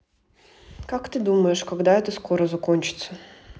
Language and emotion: Russian, neutral